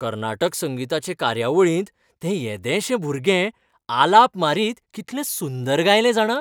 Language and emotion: Goan Konkani, happy